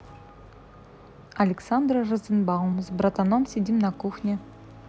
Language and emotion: Russian, neutral